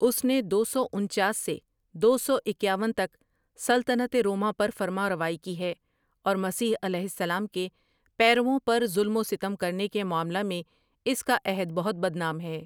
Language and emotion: Urdu, neutral